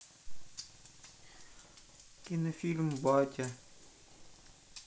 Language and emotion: Russian, sad